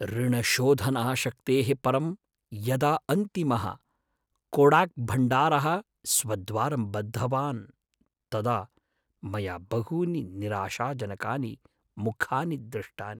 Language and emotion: Sanskrit, sad